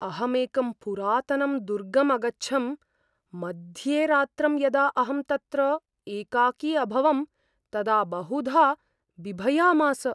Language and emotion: Sanskrit, fearful